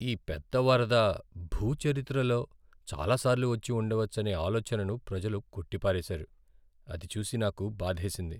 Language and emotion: Telugu, sad